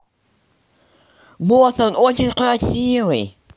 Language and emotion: Russian, positive